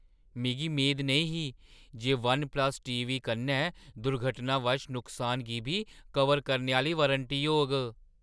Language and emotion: Dogri, surprised